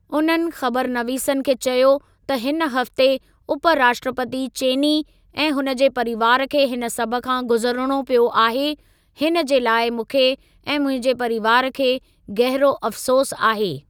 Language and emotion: Sindhi, neutral